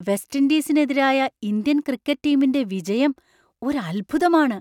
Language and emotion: Malayalam, surprised